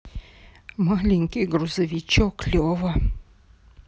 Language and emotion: Russian, sad